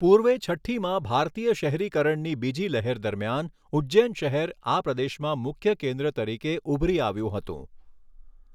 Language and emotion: Gujarati, neutral